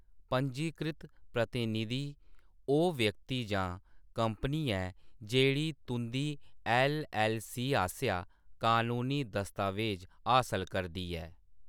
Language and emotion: Dogri, neutral